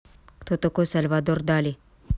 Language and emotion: Russian, angry